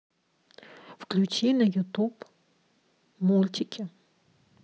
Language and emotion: Russian, neutral